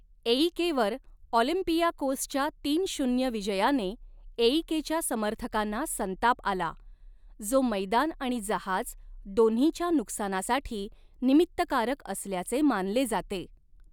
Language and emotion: Marathi, neutral